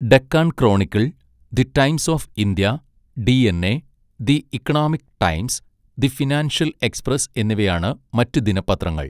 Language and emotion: Malayalam, neutral